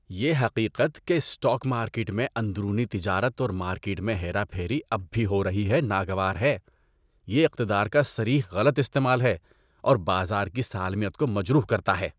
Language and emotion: Urdu, disgusted